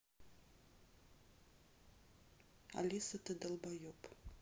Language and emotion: Russian, neutral